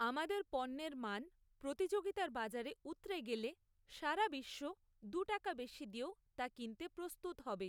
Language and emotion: Bengali, neutral